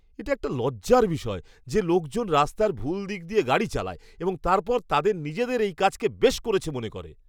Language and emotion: Bengali, disgusted